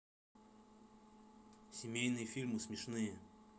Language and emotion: Russian, neutral